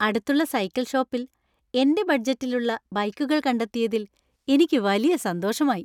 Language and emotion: Malayalam, happy